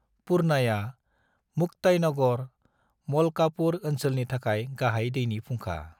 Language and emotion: Bodo, neutral